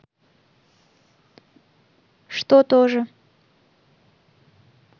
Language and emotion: Russian, neutral